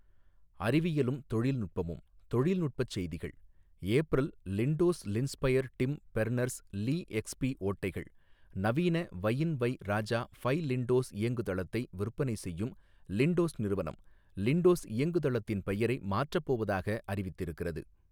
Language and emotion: Tamil, neutral